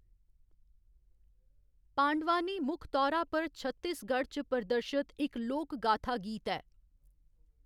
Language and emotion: Dogri, neutral